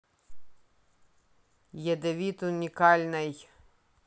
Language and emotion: Russian, neutral